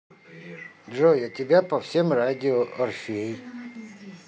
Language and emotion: Russian, neutral